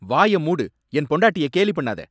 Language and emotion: Tamil, angry